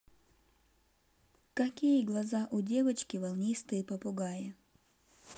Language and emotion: Russian, neutral